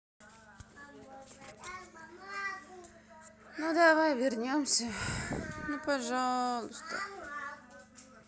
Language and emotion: Russian, sad